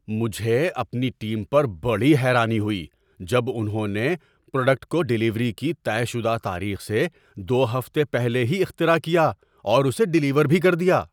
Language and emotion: Urdu, surprised